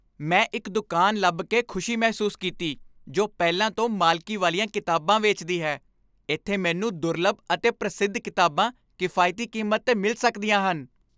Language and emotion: Punjabi, happy